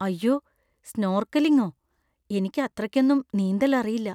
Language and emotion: Malayalam, fearful